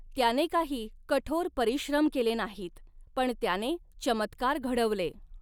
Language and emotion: Marathi, neutral